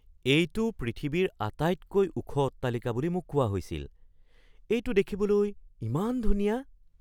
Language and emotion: Assamese, surprised